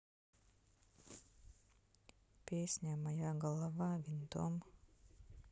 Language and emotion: Russian, sad